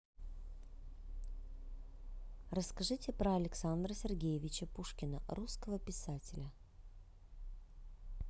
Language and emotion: Russian, neutral